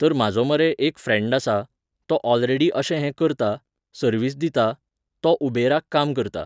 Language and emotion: Goan Konkani, neutral